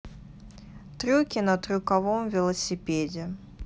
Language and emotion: Russian, neutral